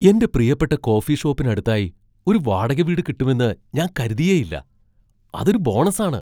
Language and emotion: Malayalam, surprised